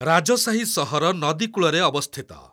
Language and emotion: Odia, neutral